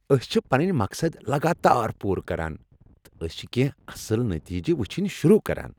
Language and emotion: Kashmiri, happy